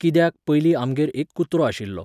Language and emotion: Goan Konkani, neutral